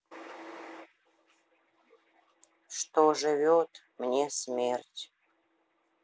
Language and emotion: Russian, sad